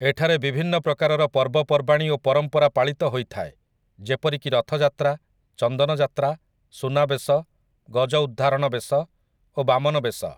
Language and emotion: Odia, neutral